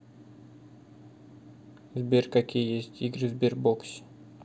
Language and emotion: Russian, neutral